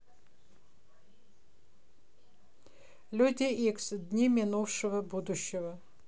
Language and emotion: Russian, neutral